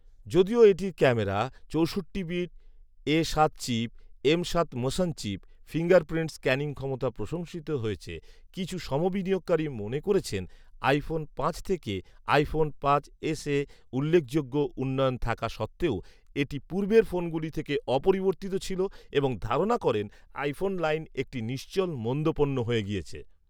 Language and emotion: Bengali, neutral